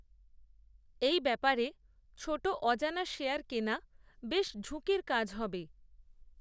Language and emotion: Bengali, neutral